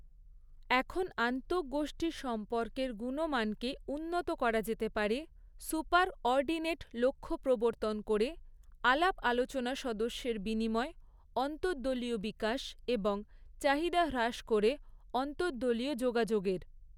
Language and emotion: Bengali, neutral